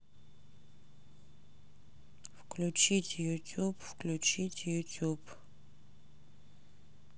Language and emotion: Russian, sad